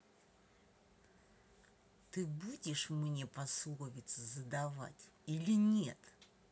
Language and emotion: Russian, angry